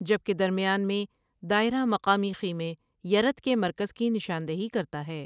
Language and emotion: Urdu, neutral